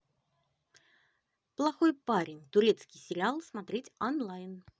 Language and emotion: Russian, positive